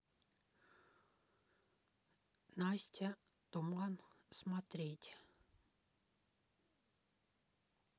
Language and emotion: Russian, neutral